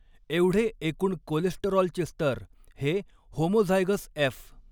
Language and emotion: Marathi, neutral